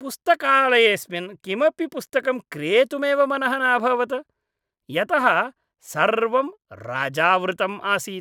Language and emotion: Sanskrit, disgusted